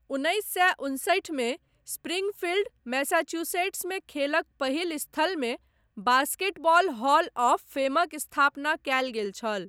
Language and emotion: Maithili, neutral